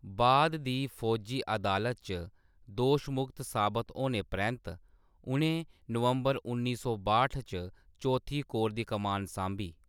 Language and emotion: Dogri, neutral